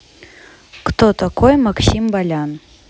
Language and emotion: Russian, neutral